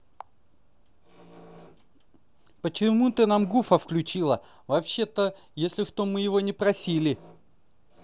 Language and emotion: Russian, angry